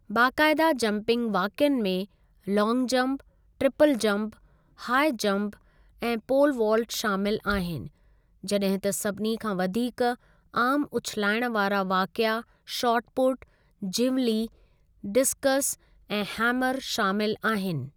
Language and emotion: Sindhi, neutral